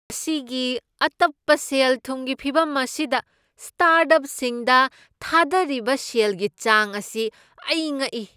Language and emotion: Manipuri, surprised